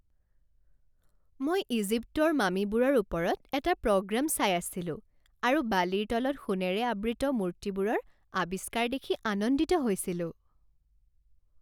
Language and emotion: Assamese, happy